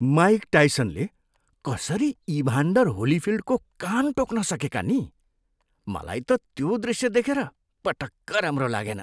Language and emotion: Nepali, disgusted